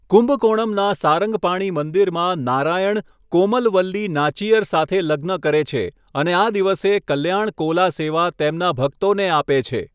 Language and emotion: Gujarati, neutral